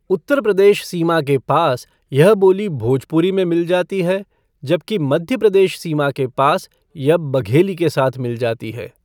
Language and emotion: Hindi, neutral